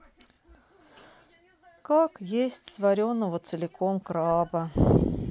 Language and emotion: Russian, sad